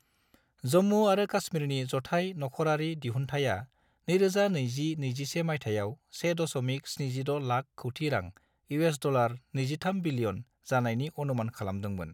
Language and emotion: Bodo, neutral